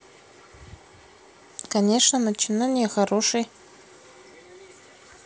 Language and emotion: Russian, neutral